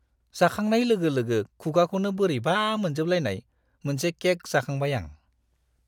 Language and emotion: Bodo, disgusted